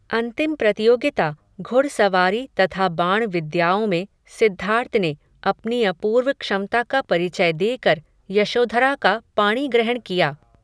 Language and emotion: Hindi, neutral